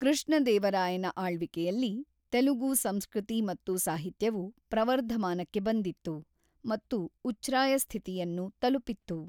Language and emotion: Kannada, neutral